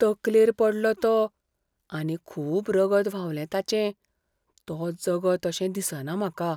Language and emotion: Goan Konkani, fearful